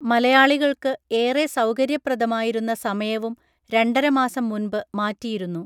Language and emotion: Malayalam, neutral